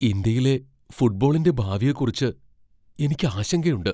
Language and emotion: Malayalam, fearful